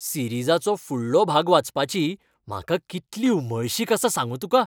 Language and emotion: Goan Konkani, happy